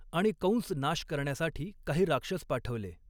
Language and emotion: Marathi, neutral